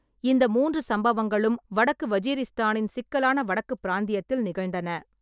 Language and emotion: Tamil, neutral